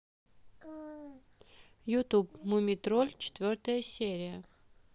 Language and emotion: Russian, neutral